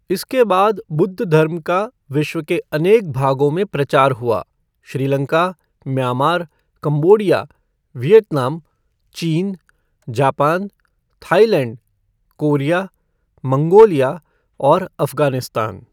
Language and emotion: Hindi, neutral